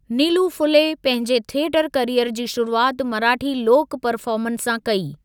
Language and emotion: Sindhi, neutral